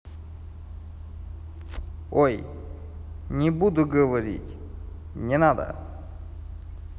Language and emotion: Russian, neutral